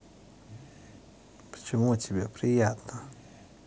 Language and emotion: Russian, neutral